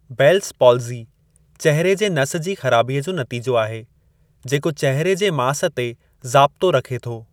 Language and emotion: Sindhi, neutral